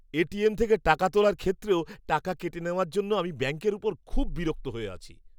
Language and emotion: Bengali, angry